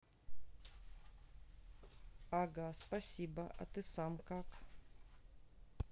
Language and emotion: Russian, neutral